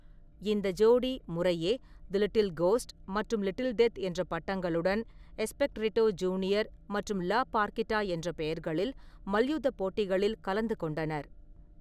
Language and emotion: Tamil, neutral